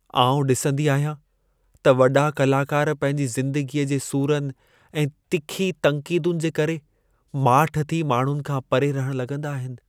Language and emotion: Sindhi, sad